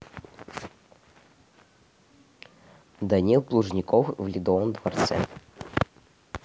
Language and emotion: Russian, neutral